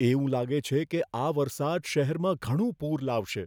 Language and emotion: Gujarati, fearful